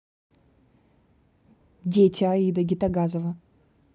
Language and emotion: Russian, neutral